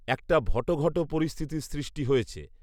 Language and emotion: Bengali, neutral